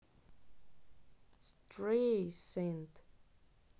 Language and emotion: Russian, neutral